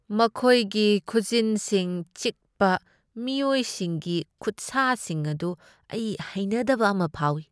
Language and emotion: Manipuri, disgusted